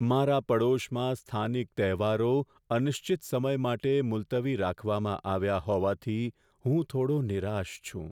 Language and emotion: Gujarati, sad